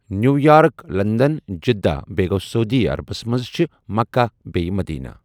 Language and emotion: Kashmiri, neutral